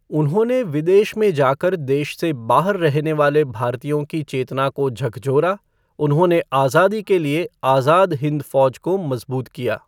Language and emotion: Hindi, neutral